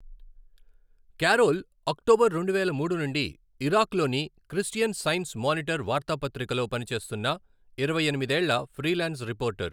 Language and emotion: Telugu, neutral